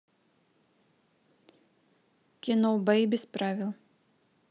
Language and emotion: Russian, neutral